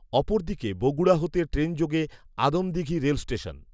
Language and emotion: Bengali, neutral